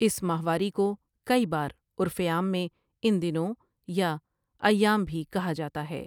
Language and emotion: Urdu, neutral